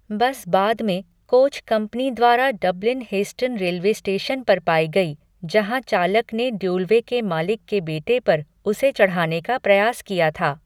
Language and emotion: Hindi, neutral